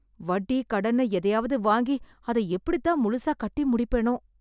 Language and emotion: Tamil, sad